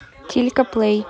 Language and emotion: Russian, neutral